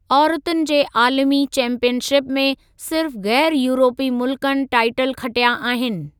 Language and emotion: Sindhi, neutral